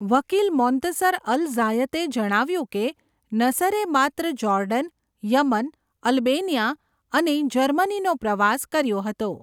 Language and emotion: Gujarati, neutral